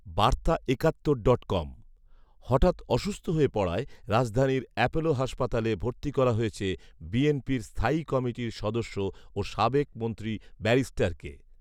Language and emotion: Bengali, neutral